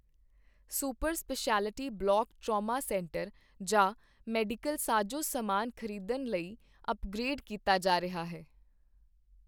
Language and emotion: Punjabi, neutral